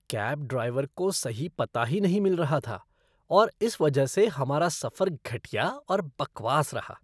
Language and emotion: Hindi, disgusted